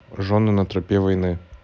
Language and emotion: Russian, neutral